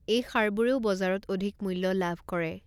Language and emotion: Assamese, neutral